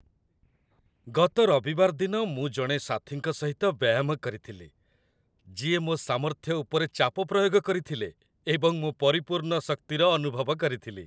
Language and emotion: Odia, happy